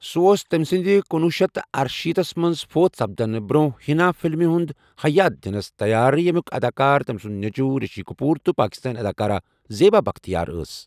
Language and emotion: Kashmiri, neutral